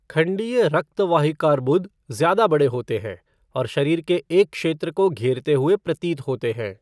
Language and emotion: Hindi, neutral